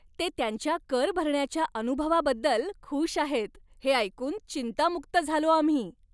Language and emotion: Marathi, happy